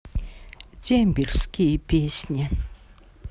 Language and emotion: Russian, sad